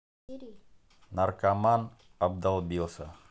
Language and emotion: Russian, neutral